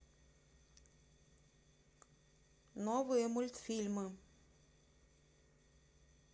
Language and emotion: Russian, neutral